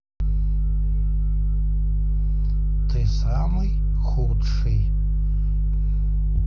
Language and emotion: Russian, neutral